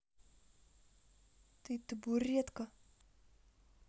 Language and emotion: Russian, angry